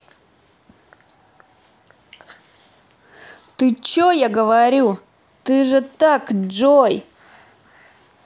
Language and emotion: Russian, angry